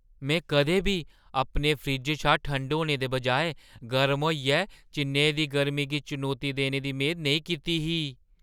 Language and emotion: Dogri, surprised